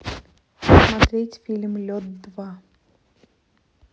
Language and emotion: Russian, neutral